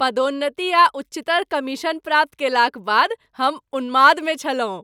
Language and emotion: Maithili, happy